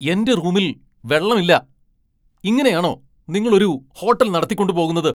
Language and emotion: Malayalam, angry